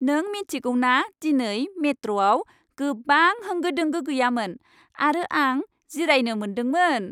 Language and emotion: Bodo, happy